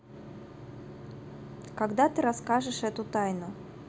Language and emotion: Russian, neutral